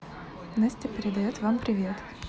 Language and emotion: Russian, neutral